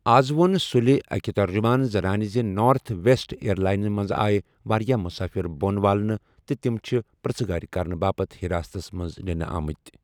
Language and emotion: Kashmiri, neutral